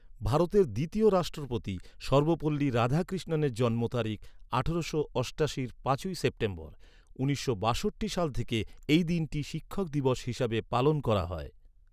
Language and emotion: Bengali, neutral